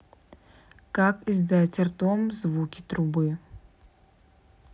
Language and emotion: Russian, neutral